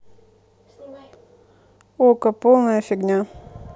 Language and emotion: Russian, neutral